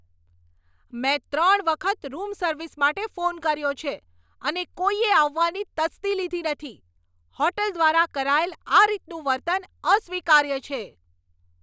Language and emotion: Gujarati, angry